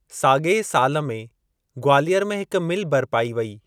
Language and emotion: Sindhi, neutral